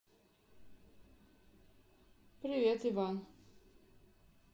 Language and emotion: Russian, neutral